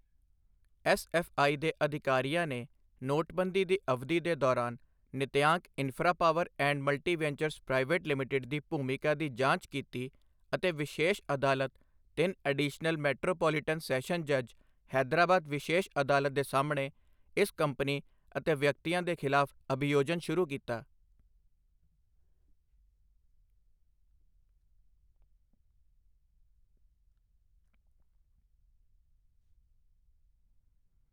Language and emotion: Punjabi, neutral